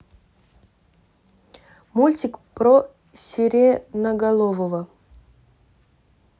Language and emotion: Russian, neutral